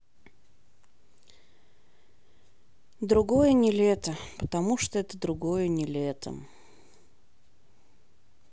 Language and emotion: Russian, sad